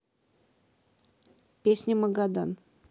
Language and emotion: Russian, neutral